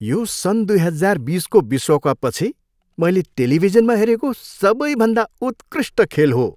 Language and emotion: Nepali, happy